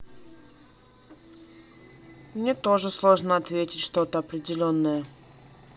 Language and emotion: Russian, neutral